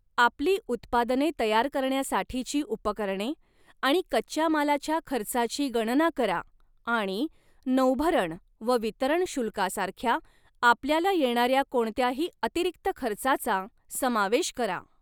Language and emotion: Marathi, neutral